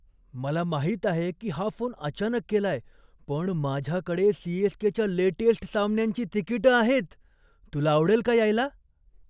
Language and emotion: Marathi, surprised